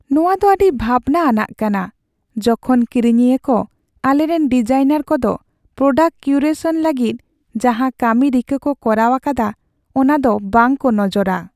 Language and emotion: Santali, sad